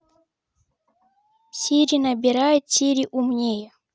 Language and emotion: Russian, neutral